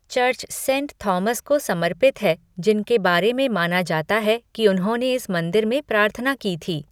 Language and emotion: Hindi, neutral